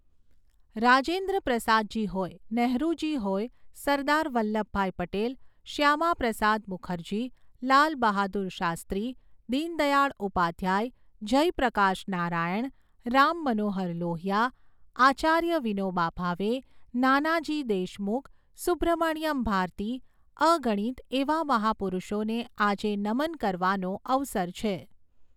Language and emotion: Gujarati, neutral